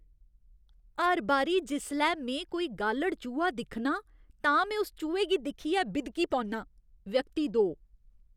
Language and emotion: Dogri, disgusted